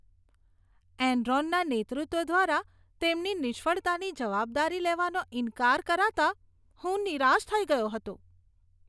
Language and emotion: Gujarati, disgusted